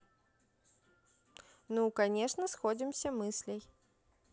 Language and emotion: Russian, neutral